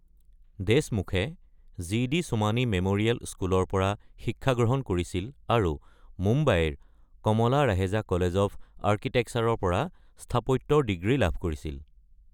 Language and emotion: Assamese, neutral